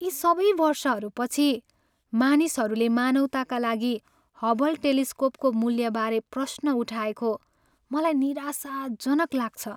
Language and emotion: Nepali, sad